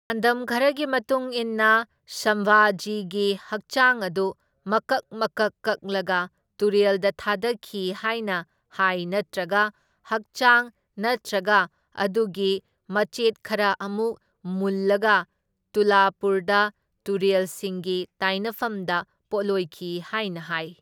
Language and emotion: Manipuri, neutral